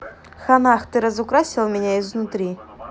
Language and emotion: Russian, neutral